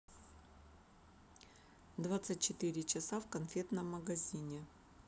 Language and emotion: Russian, neutral